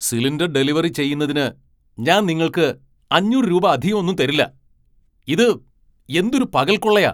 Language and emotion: Malayalam, angry